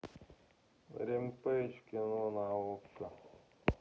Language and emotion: Russian, sad